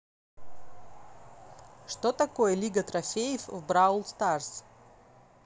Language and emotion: Russian, neutral